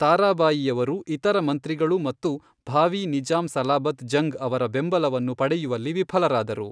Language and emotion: Kannada, neutral